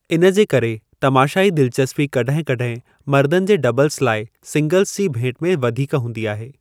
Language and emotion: Sindhi, neutral